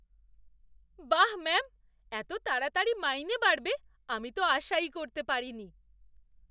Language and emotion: Bengali, surprised